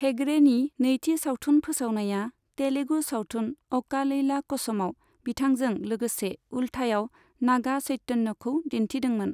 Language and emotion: Bodo, neutral